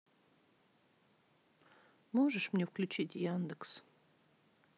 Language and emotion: Russian, sad